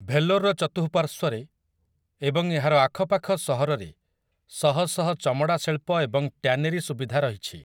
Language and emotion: Odia, neutral